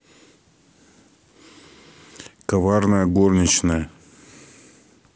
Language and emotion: Russian, neutral